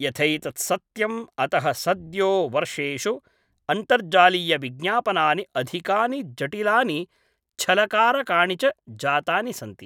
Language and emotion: Sanskrit, neutral